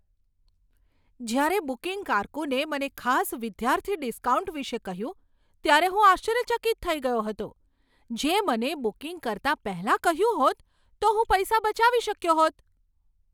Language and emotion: Gujarati, surprised